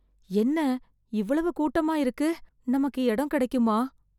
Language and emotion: Tamil, fearful